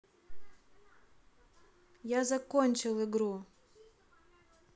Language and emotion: Russian, neutral